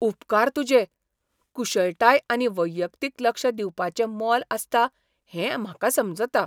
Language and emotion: Goan Konkani, surprised